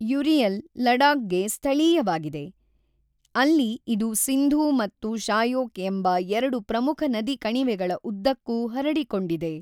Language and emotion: Kannada, neutral